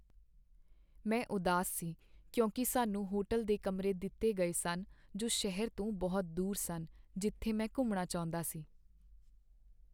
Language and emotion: Punjabi, sad